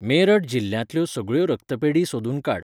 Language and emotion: Goan Konkani, neutral